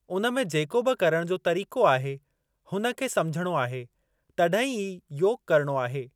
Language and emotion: Sindhi, neutral